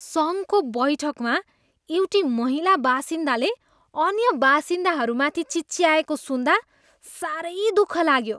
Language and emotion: Nepali, disgusted